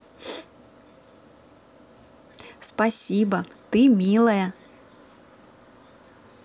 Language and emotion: Russian, positive